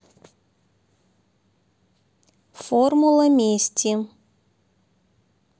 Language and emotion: Russian, neutral